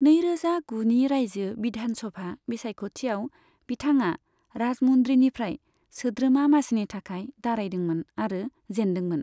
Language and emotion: Bodo, neutral